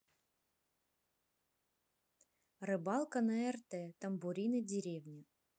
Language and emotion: Russian, neutral